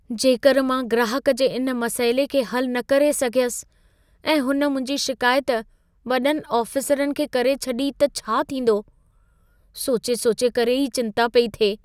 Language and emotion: Sindhi, fearful